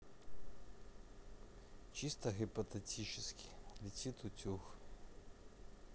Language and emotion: Russian, neutral